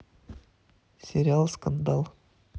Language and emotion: Russian, neutral